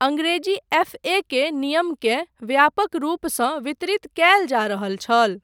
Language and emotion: Maithili, neutral